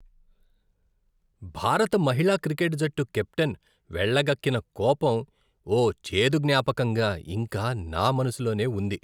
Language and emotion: Telugu, disgusted